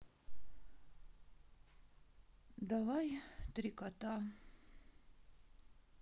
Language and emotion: Russian, sad